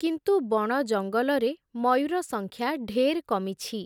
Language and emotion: Odia, neutral